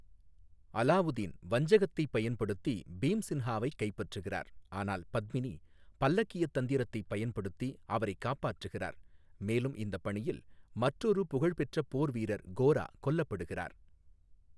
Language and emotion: Tamil, neutral